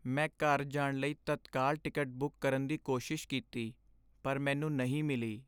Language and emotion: Punjabi, sad